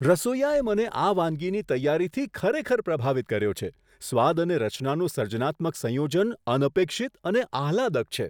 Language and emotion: Gujarati, surprised